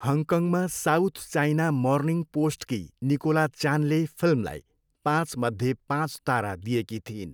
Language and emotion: Nepali, neutral